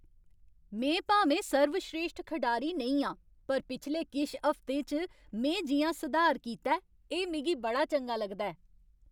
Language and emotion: Dogri, happy